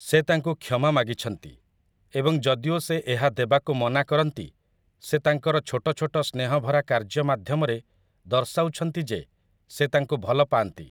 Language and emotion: Odia, neutral